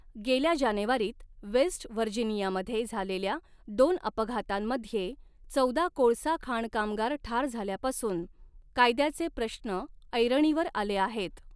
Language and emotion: Marathi, neutral